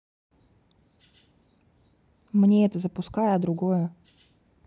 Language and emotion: Russian, neutral